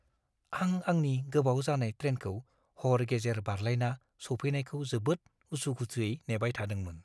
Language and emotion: Bodo, fearful